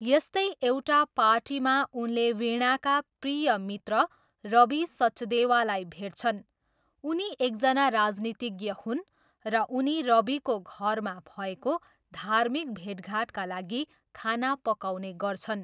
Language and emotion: Nepali, neutral